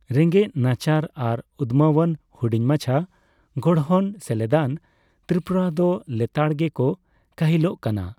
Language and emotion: Santali, neutral